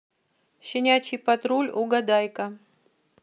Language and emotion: Russian, neutral